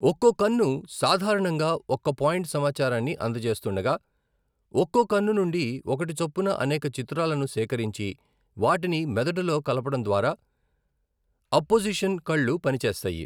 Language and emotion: Telugu, neutral